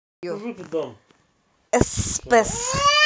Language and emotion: Russian, neutral